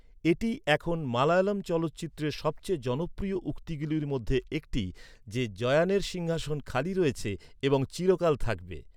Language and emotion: Bengali, neutral